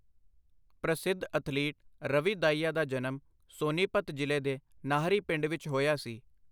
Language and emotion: Punjabi, neutral